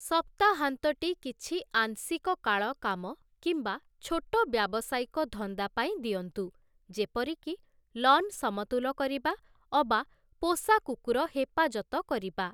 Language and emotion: Odia, neutral